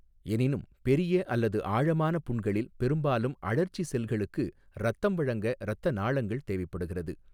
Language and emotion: Tamil, neutral